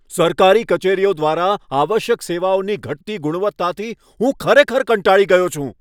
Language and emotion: Gujarati, angry